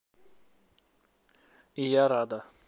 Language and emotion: Russian, neutral